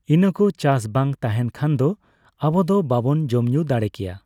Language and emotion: Santali, neutral